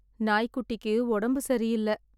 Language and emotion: Tamil, sad